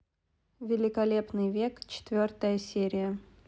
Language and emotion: Russian, neutral